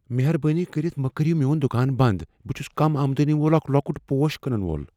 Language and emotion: Kashmiri, fearful